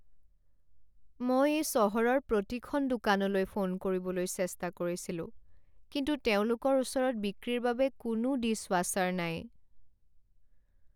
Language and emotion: Assamese, sad